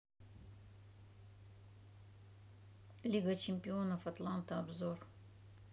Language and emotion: Russian, neutral